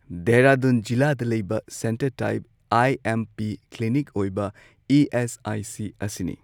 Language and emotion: Manipuri, neutral